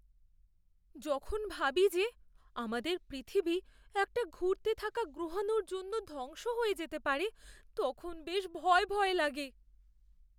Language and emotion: Bengali, fearful